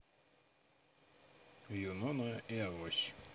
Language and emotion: Russian, neutral